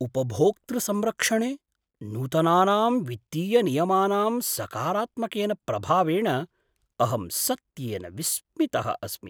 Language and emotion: Sanskrit, surprised